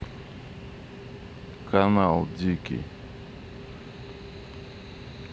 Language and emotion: Russian, neutral